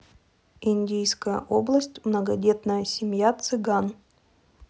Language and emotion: Russian, neutral